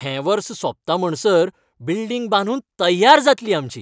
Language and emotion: Goan Konkani, happy